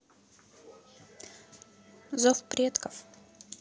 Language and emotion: Russian, neutral